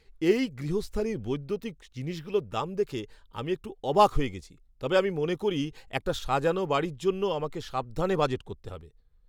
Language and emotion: Bengali, surprised